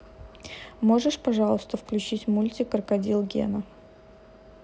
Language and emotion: Russian, neutral